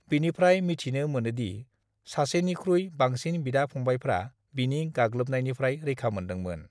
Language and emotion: Bodo, neutral